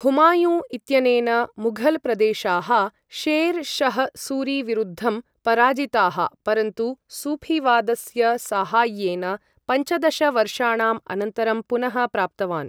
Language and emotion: Sanskrit, neutral